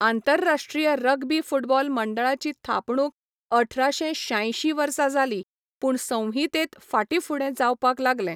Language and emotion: Goan Konkani, neutral